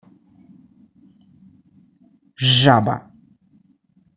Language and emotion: Russian, angry